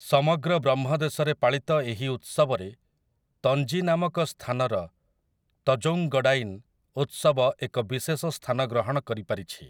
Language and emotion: Odia, neutral